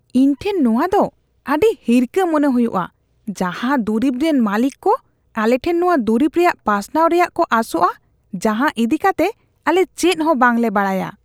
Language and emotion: Santali, disgusted